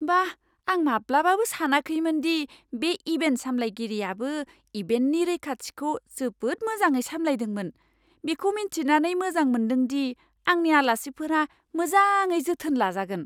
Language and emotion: Bodo, surprised